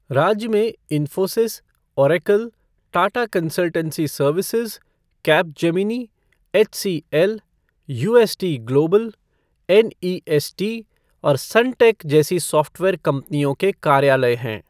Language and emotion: Hindi, neutral